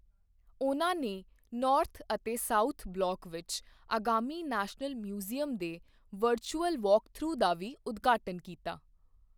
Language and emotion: Punjabi, neutral